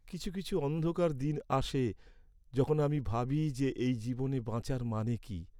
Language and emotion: Bengali, sad